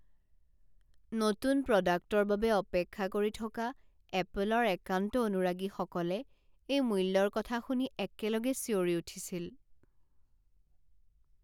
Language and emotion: Assamese, sad